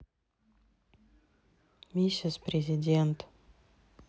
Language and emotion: Russian, sad